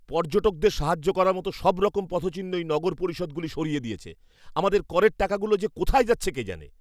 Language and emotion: Bengali, angry